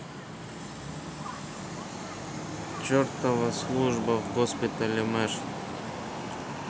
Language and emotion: Russian, sad